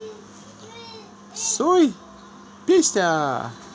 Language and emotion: Russian, positive